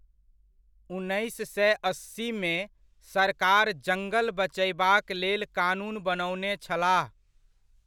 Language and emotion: Maithili, neutral